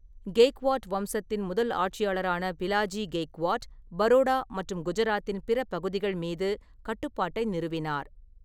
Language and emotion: Tamil, neutral